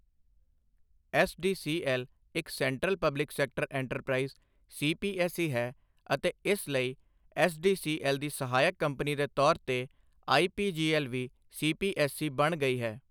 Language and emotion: Punjabi, neutral